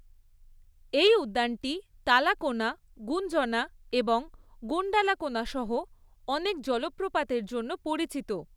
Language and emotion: Bengali, neutral